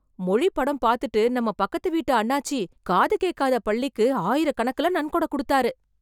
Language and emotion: Tamil, surprised